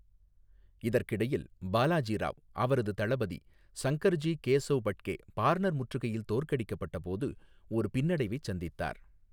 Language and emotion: Tamil, neutral